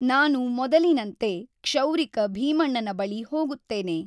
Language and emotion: Kannada, neutral